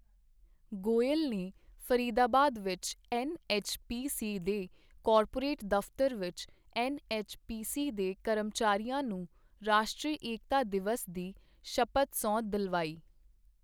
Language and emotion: Punjabi, neutral